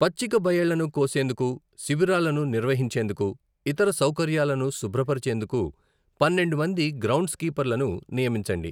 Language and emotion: Telugu, neutral